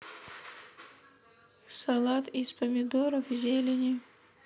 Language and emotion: Russian, neutral